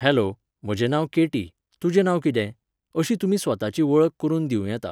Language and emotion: Goan Konkani, neutral